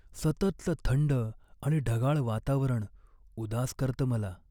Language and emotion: Marathi, sad